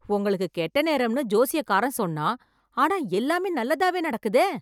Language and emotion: Tamil, surprised